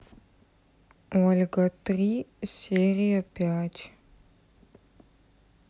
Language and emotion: Russian, neutral